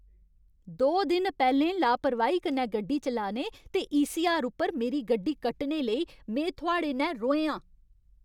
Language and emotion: Dogri, angry